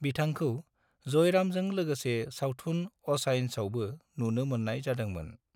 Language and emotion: Bodo, neutral